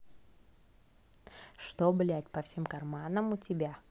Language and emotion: Russian, neutral